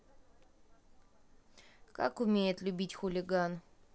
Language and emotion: Russian, neutral